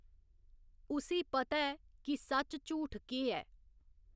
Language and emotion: Dogri, neutral